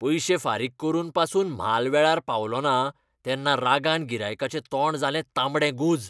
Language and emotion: Goan Konkani, angry